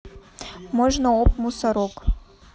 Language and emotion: Russian, neutral